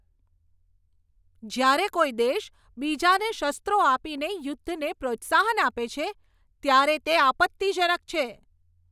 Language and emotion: Gujarati, angry